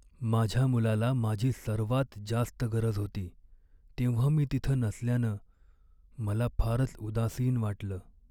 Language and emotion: Marathi, sad